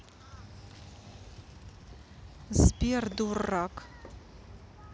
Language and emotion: Russian, neutral